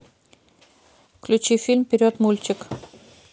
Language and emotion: Russian, neutral